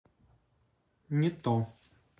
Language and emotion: Russian, neutral